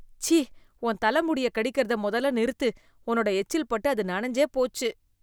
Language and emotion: Tamil, disgusted